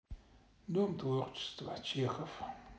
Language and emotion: Russian, sad